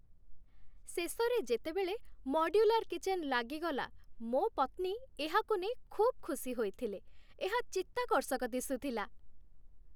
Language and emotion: Odia, happy